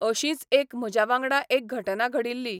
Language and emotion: Goan Konkani, neutral